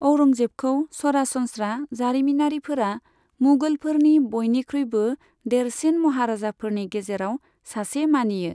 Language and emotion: Bodo, neutral